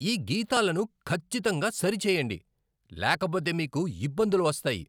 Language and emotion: Telugu, angry